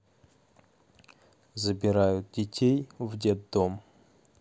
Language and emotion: Russian, neutral